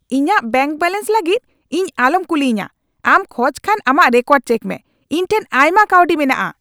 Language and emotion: Santali, angry